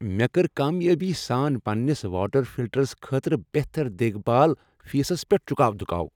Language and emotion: Kashmiri, happy